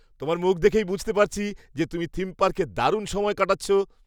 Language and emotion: Bengali, happy